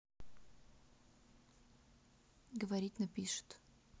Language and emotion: Russian, neutral